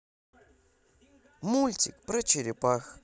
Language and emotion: Russian, positive